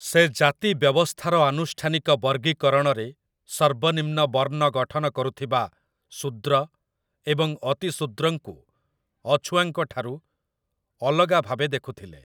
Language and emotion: Odia, neutral